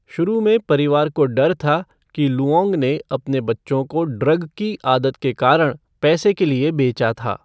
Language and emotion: Hindi, neutral